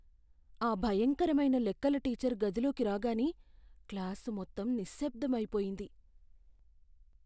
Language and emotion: Telugu, fearful